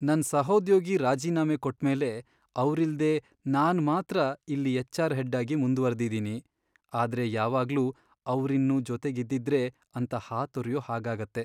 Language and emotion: Kannada, sad